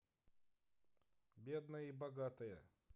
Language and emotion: Russian, neutral